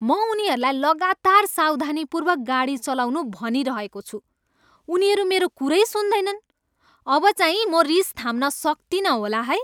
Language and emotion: Nepali, angry